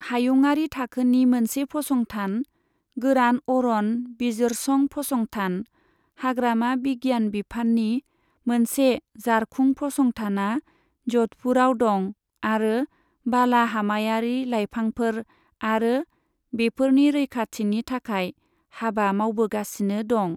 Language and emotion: Bodo, neutral